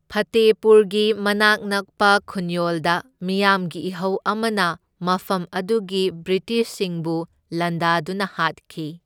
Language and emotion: Manipuri, neutral